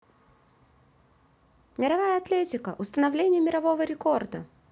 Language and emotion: Russian, positive